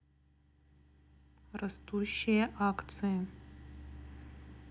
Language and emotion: Russian, neutral